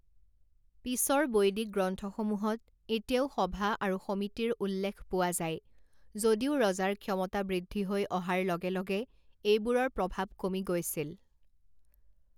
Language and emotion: Assamese, neutral